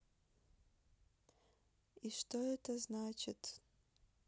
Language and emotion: Russian, sad